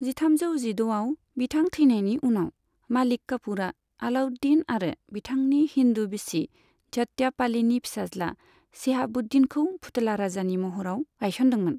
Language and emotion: Bodo, neutral